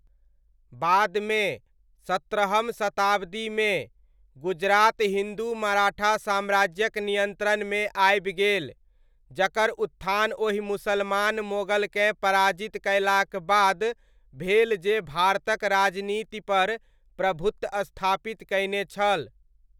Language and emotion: Maithili, neutral